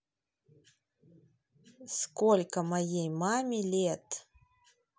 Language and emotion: Russian, neutral